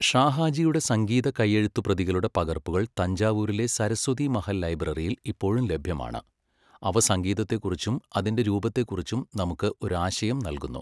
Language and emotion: Malayalam, neutral